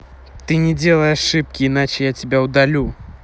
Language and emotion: Russian, angry